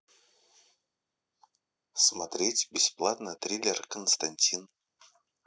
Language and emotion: Russian, neutral